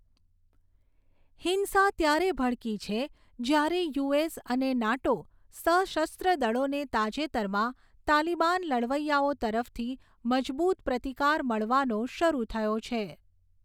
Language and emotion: Gujarati, neutral